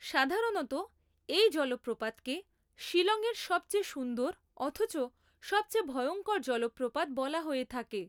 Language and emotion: Bengali, neutral